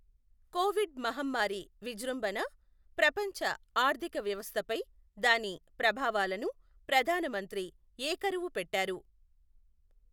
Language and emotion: Telugu, neutral